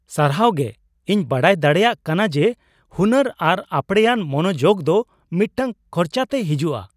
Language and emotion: Santali, surprised